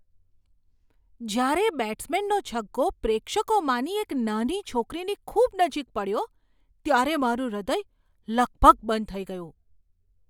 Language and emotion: Gujarati, surprised